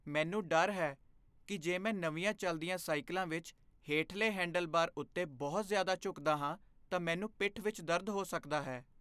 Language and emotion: Punjabi, fearful